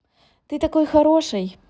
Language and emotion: Russian, positive